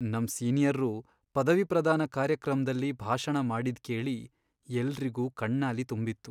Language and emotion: Kannada, sad